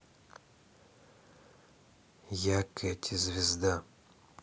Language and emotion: Russian, neutral